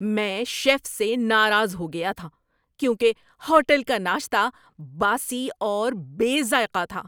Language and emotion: Urdu, angry